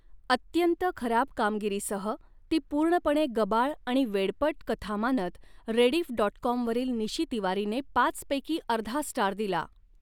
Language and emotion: Marathi, neutral